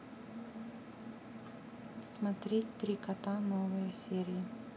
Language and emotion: Russian, neutral